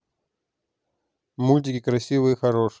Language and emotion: Russian, neutral